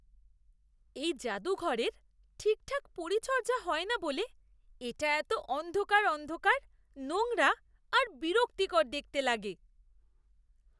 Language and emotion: Bengali, disgusted